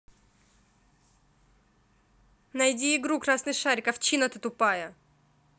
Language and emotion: Russian, angry